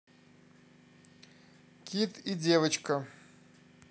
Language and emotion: Russian, neutral